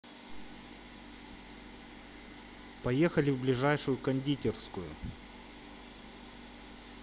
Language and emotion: Russian, neutral